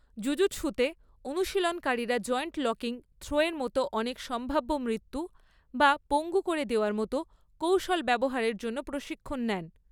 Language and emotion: Bengali, neutral